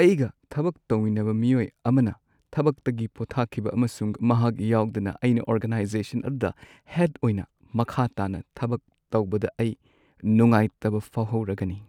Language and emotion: Manipuri, sad